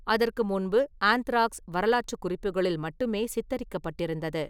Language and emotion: Tamil, neutral